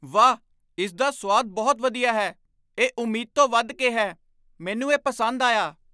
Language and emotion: Punjabi, surprised